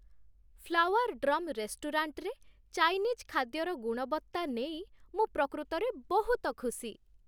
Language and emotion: Odia, happy